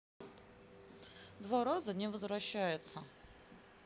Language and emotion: Russian, neutral